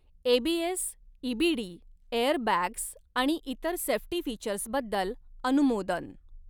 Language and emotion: Marathi, neutral